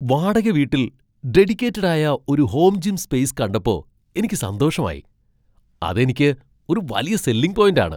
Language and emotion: Malayalam, surprised